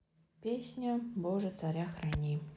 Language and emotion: Russian, neutral